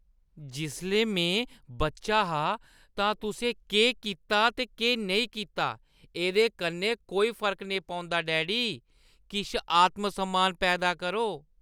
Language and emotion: Dogri, disgusted